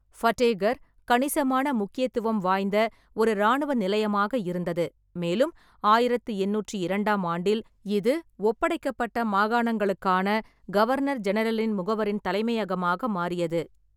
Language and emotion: Tamil, neutral